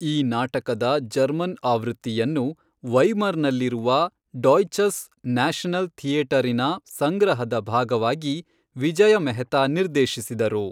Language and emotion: Kannada, neutral